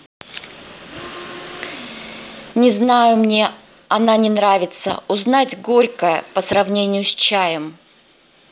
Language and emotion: Russian, neutral